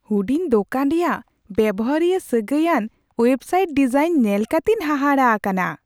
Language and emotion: Santali, surprised